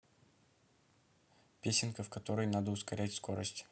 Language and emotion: Russian, neutral